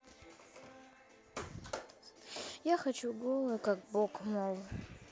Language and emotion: Russian, sad